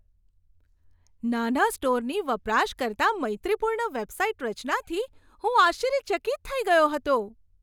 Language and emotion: Gujarati, surprised